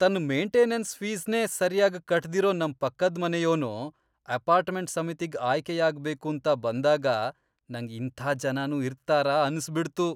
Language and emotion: Kannada, disgusted